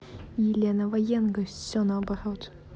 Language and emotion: Russian, angry